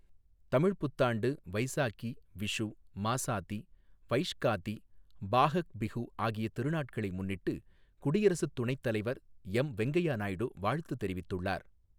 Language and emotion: Tamil, neutral